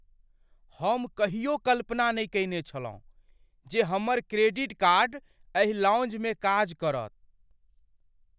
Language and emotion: Maithili, surprised